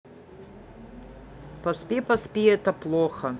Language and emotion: Russian, neutral